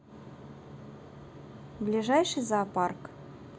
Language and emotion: Russian, neutral